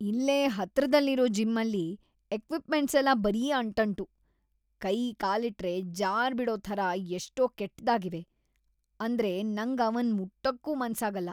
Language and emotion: Kannada, disgusted